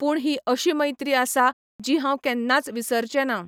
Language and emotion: Goan Konkani, neutral